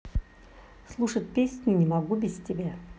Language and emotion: Russian, neutral